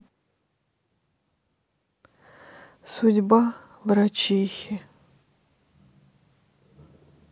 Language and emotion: Russian, sad